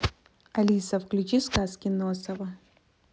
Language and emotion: Russian, neutral